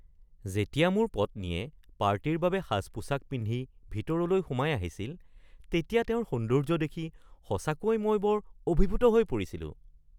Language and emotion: Assamese, surprised